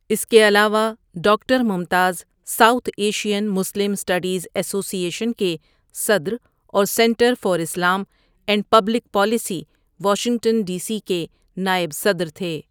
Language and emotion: Urdu, neutral